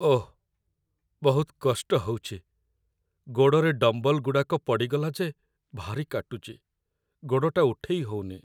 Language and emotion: Odia, sad